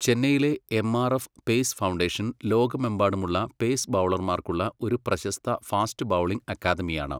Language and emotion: Malayalam, neutral